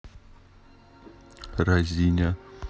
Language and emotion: Russian, neutral